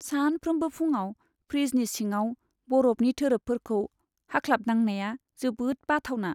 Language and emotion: Bodo, sad